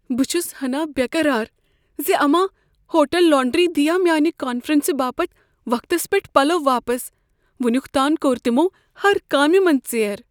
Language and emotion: Kashmiri, fearful